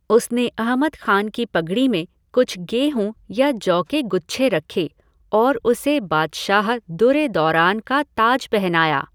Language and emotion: Hindi, neutral